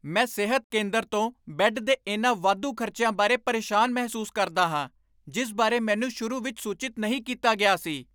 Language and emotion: Punjabi, angry